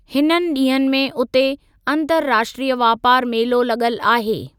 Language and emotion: Sindhi, neutral